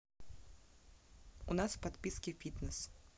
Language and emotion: Russian, neutral